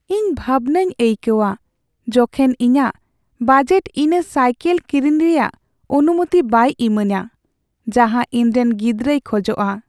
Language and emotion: Santali, sad